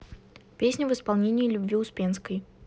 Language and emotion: Russian, neutral